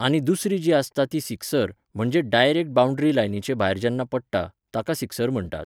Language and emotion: Goan Konkani, neutral